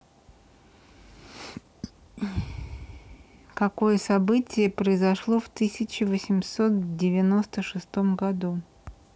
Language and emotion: Russian, neutral